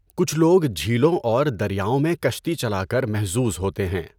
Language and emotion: Urdu, neutral